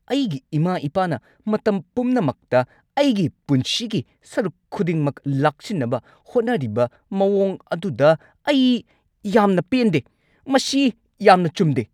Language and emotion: Manipuri, angry